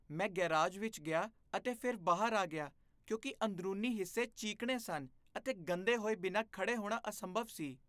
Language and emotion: Punjabi, disgusted